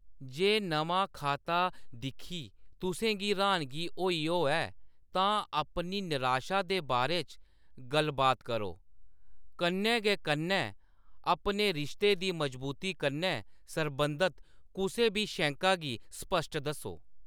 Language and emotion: Dogri, neutral